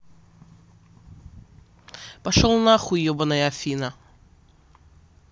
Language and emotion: Russian, angry